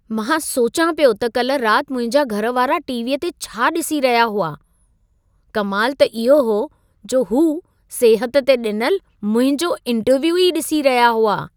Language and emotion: Sindhi, surprised